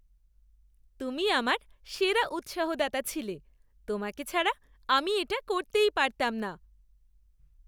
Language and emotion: Bengali, happy